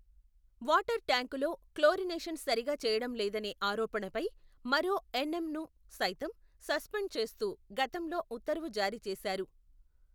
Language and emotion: Telugu, neutral